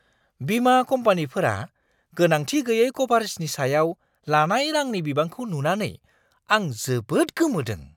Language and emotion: Bodo, surprised